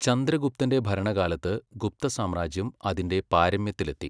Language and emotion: Malayalam, neutral